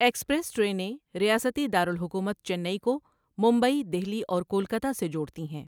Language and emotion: Urdu, neutral